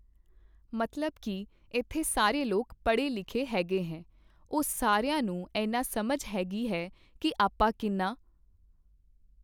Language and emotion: Punjabi, neutral